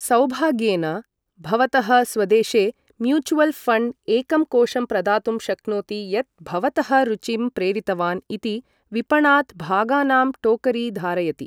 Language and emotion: Sanskrit, neutral